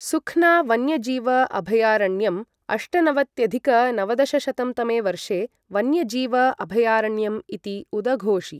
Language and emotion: Sanskrit, neutral